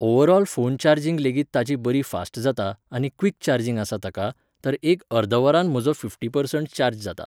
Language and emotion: Goan Konkani, neutral